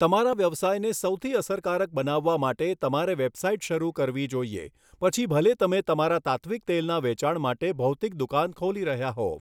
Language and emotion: Gujarati, neutral